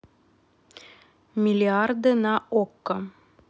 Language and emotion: Russian, neutral